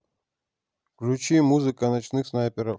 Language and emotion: Russian, neutral